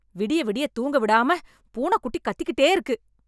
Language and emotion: Tamil, angry